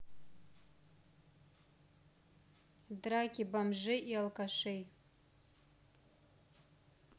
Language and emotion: Russian, neutral